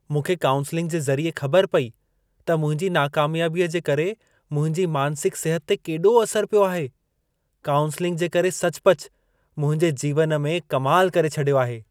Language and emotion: Sindhi, surprised